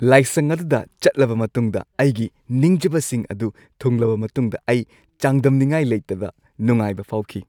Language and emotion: Manipuri, happy